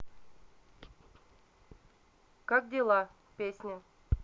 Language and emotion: Russian, neutral